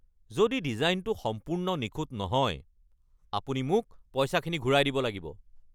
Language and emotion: Assamese, angry